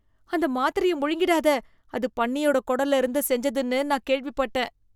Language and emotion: Tamil, disgusted